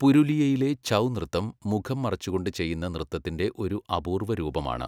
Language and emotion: Malayalam, neutral